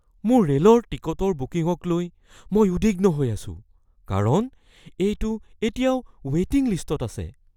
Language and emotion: Assamese, fearful